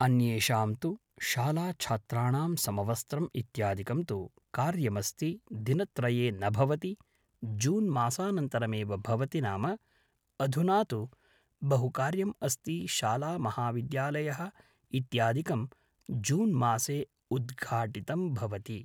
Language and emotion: Sanskrit, neutral